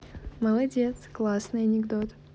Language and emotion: Russian, positive